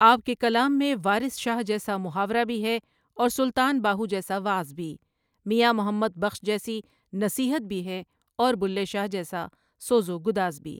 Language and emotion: Urdu, neutral